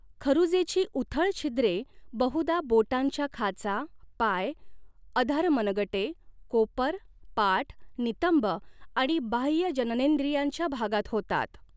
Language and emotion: Marathi, neutral